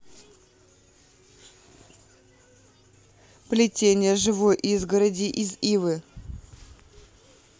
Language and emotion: Russian, neutral